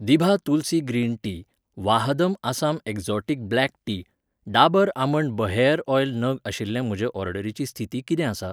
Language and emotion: Goan Konkani, neutral